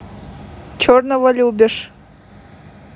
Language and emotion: Russian, neutral